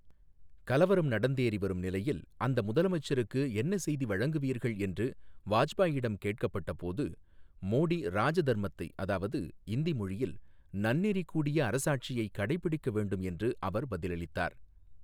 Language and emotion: Tamil, neutral